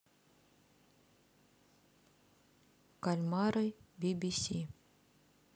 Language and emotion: Russian, neutral